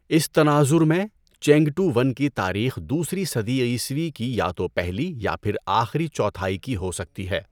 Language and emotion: Urdu, neutral